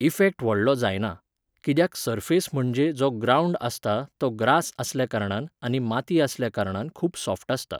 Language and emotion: Goan Konkani, neutral